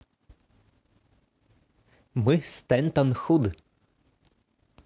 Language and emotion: Russian, positive